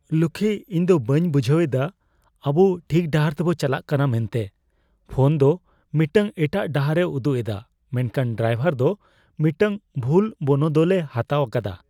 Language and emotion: Santali, fearful